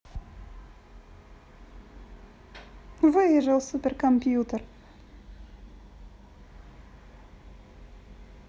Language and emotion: Russian, positive